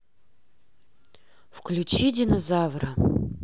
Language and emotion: Russian, neutral